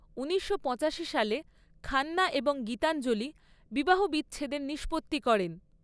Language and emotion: Bengali, neutral